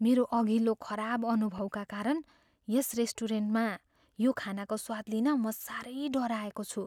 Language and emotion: Nepali, fearful